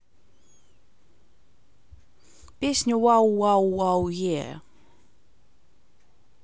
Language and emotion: Russian, neutral